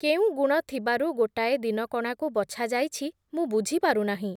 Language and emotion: Odia, neutral